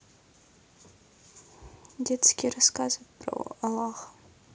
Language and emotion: Russian, neutral